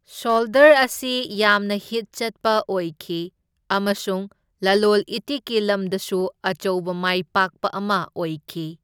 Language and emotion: Manipuri, neutral